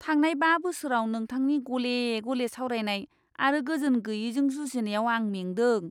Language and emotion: Bodo, disgusted